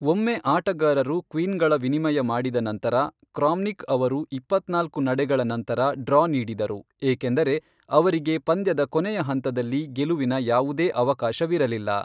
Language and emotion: Kannada, neutral